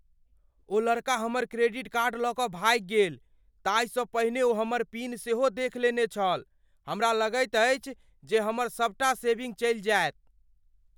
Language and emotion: Maithili, fearful